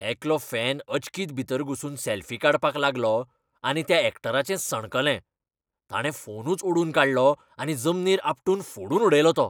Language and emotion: Goan Konkani, angry